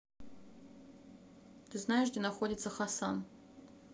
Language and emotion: Russian, neutral